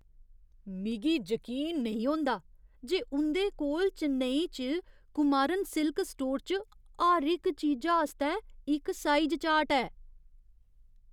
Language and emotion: Dogri, surprised